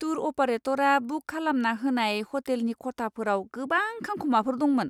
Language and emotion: Bodo, disgusted